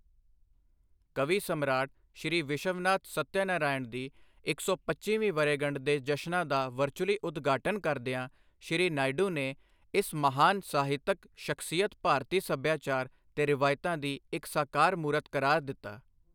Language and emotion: Punjabi, neutral